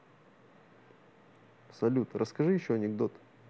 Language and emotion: Russian, neutral